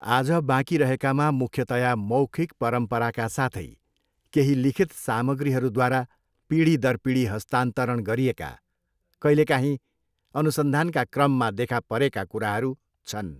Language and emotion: Nepali, neutral